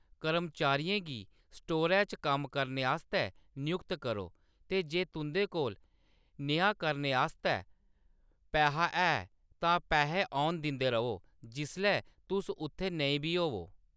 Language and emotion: Dogri, neutral